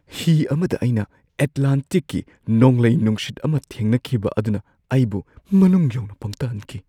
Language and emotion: Manipuri, surprised